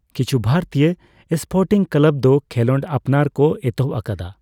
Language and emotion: Santali, neutral